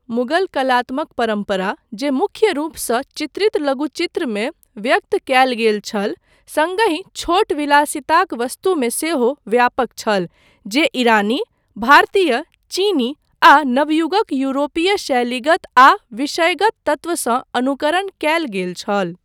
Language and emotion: Maithili, neutral